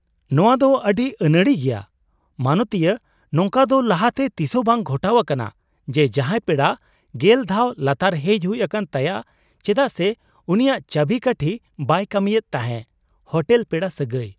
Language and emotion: Santali, surprised